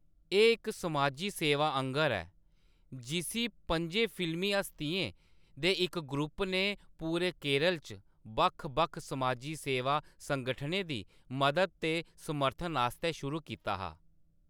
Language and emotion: Dogri, neutral